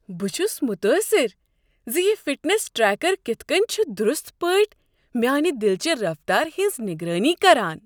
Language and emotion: Kashmiri, surprised